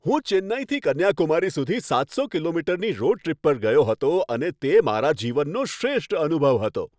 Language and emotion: Gujarati, happy